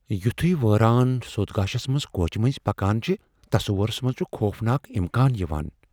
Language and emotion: Kashmiri, fearful